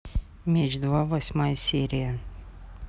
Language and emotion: Russian, neutral